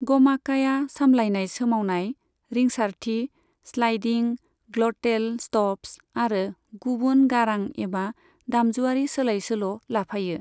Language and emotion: Bodo, neutral